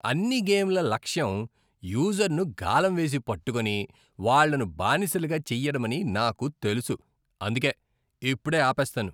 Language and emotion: Telugu, disgusted